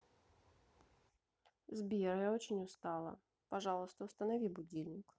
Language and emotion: Russian, sad